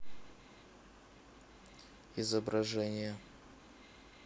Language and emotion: Russian, neutral